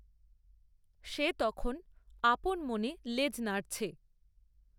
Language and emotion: Bengali, neutral